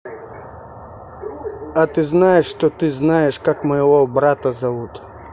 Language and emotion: Russian, neutral